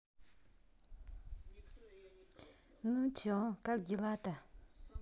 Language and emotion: Russian, positive